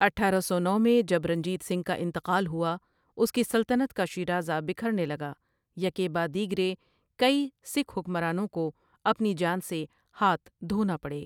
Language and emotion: Urdu, neutral